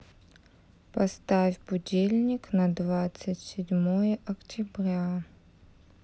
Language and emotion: Russian, neutral